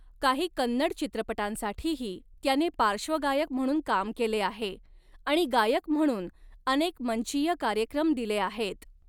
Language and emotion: Marathi, neutral